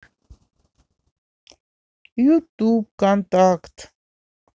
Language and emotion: Russian, neutral